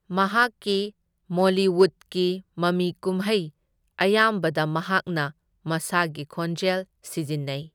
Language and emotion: Manipuri, neutral